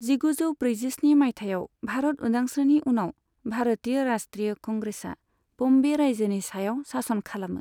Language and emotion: Bodo, neutral